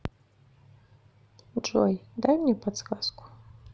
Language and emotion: Russian, neutral